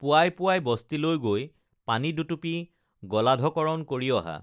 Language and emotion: Assamese, neutral